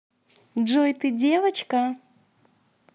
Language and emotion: Russian, positive